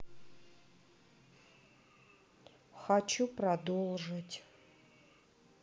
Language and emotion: Russian, sad